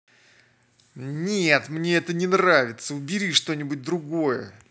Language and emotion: Russian, angry